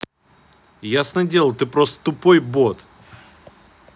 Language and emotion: Russian, angry